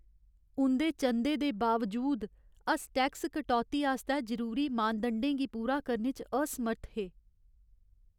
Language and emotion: Dogri, sad